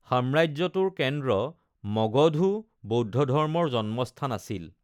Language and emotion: Assamese, neutral